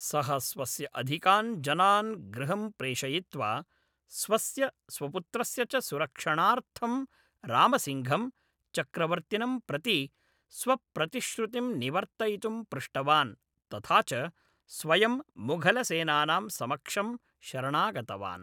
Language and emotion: Sanskrit, neutral